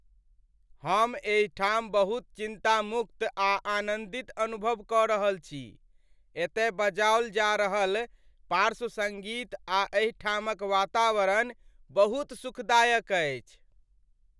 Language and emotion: Maithili, happy